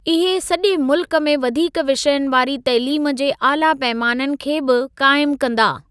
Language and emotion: Sindhi, neutral